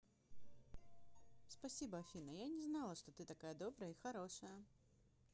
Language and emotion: Russian, positive